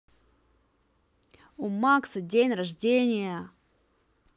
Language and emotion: Russian, positive